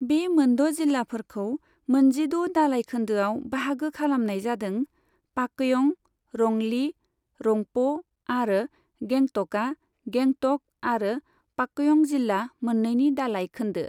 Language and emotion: Bodo, neutral